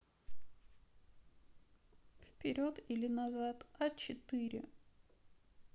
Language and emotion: Russian, sad